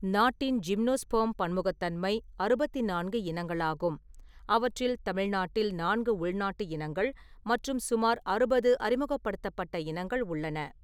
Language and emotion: Tamil, neutral